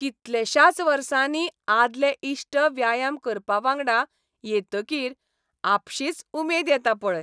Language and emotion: Goan Konkani, happy